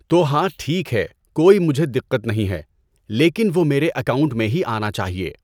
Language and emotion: Urdu, neutral